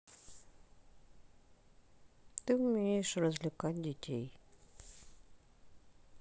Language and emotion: Russian, sad